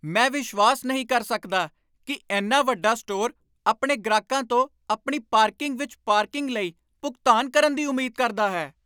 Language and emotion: Punjabi, angry